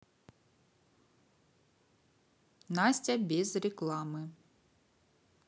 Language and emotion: Russian, neutral